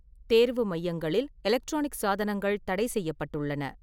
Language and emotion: Tamil, neutral